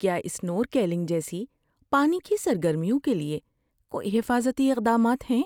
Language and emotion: Urdu, fearful